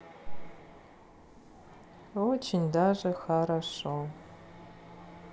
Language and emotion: Russian, sad